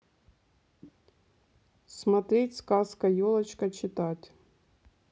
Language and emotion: Russian, neutral